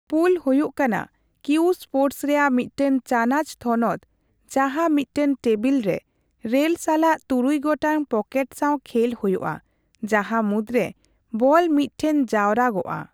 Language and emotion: Santali, neutral